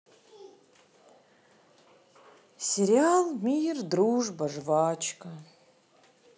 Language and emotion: Russian, sad